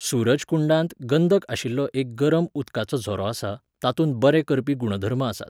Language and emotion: Goan Konkani, neutral